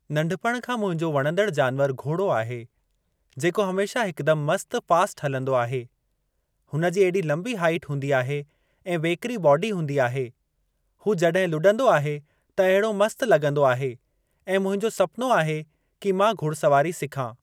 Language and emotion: Sindhi, neutral